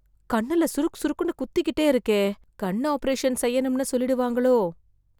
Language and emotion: Tamil, fearful